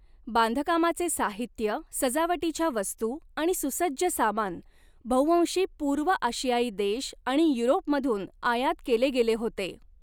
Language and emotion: Marathi, neutral